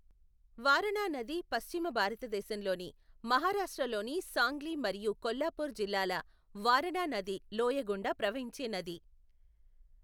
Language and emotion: Telugu, neutral